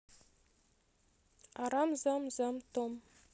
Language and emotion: Russian, neutral